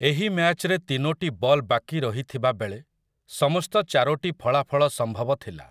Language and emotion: Odia, neutral